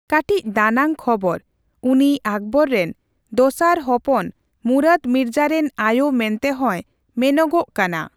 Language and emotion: Santali, neutral